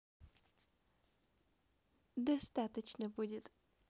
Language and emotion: Russian, positive